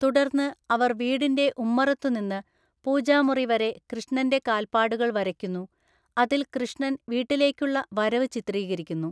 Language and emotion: Malayalam, neutral